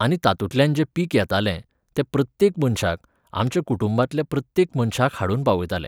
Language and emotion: Goan Konkani, neutral